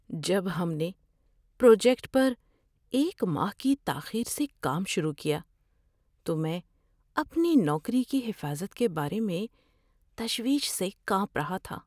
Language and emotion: Urdu, fearful